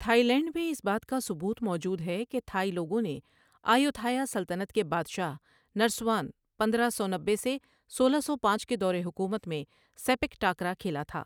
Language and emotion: Urdu, neutral